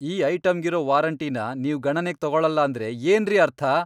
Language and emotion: Kannada, angry